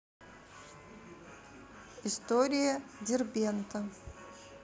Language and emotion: Russian, neutral